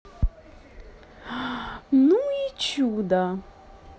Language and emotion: Russian, positive